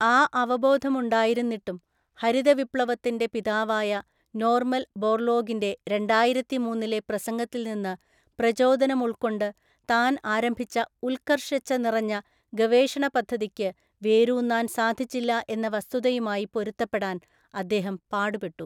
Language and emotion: Malayalam, neutral